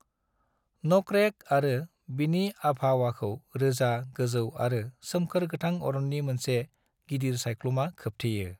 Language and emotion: Bodo, neutral